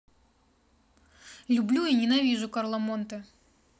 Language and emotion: Russian, angry